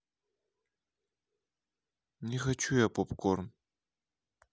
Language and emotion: Russian, sad